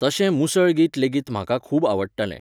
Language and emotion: Goan Konkani, neutral